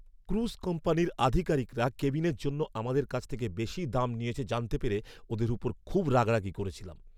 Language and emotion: Bengali, angry